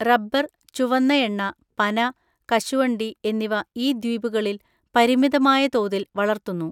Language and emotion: Malayalam, neutral